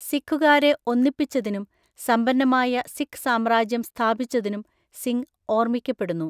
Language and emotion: Malayalam, neutral